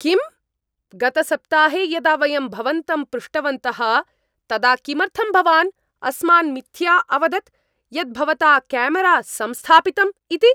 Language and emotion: Sanskrit, angry